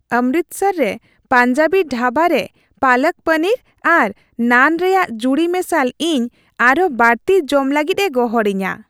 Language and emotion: Santali, happy